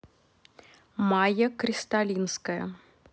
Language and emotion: Russian, neutral